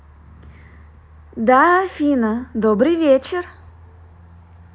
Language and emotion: Russian, positive